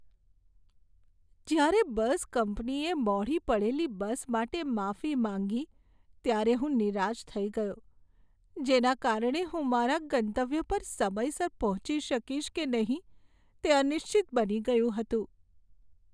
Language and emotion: Gujarati, sad